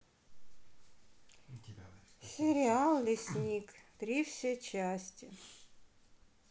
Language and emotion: Russian, neutral